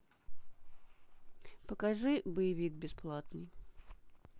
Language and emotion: Russian, neutral